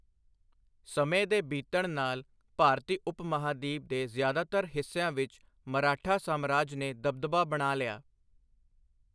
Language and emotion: Punjabi, neutral